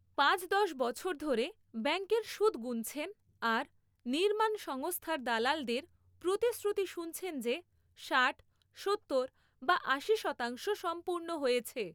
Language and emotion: Bengali, neutral